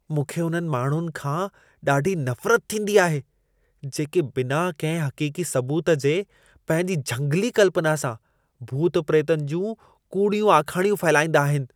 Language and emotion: Sindhi, disgusted